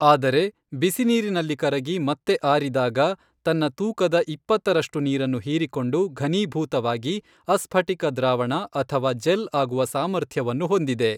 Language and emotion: Kannada, neutral